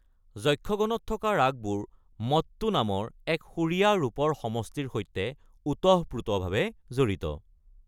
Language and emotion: Assamese, neutral